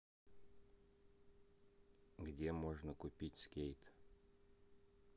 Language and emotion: Russian, neutral